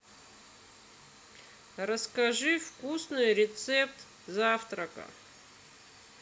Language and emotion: Russian, neutral